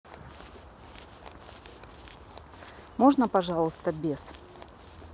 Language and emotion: Russian, neutral